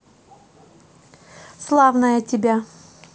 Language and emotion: Russian, positive